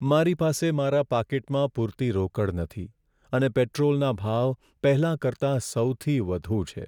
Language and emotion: Gujarati, sad